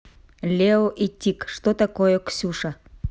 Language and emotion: Russian, neutral